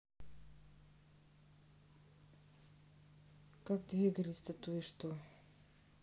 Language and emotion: Russian, neutral